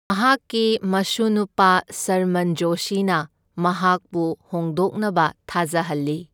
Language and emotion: Manipuri, neutral